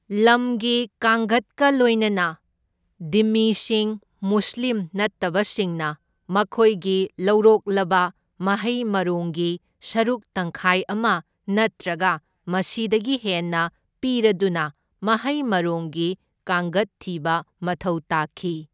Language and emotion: Manipuri, neutral